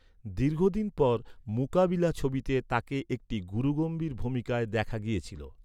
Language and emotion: Bengali, neutral